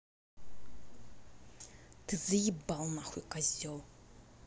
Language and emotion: Russian, angry